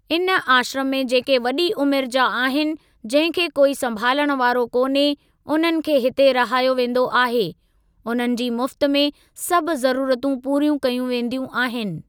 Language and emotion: Sindhi, neutral